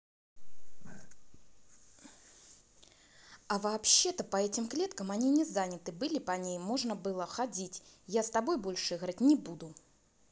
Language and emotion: Russian, angry